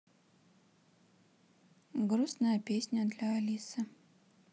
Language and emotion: Russian, neutral